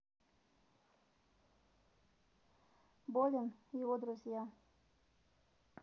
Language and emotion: Russian, neutral